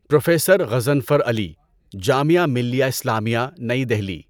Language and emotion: Urdu, neutral